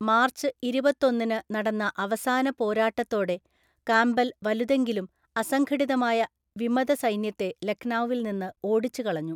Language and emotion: Malayalam, neutral